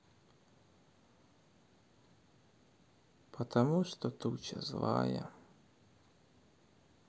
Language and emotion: Russian, sad